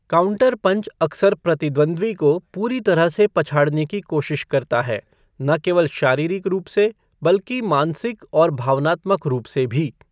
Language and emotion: Hindi, neutral